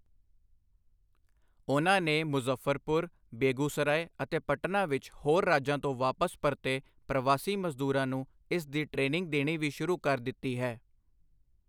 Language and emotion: Punjabi, neutral